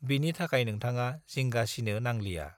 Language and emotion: Bodo, neutral